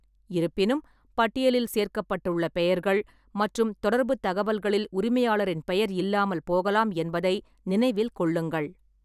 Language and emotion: Tamil, neutral